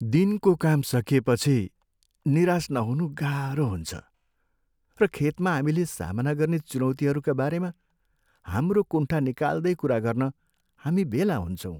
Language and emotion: Nepali, sad